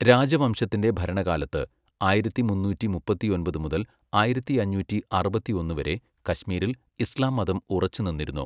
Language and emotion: Malayalam, neutral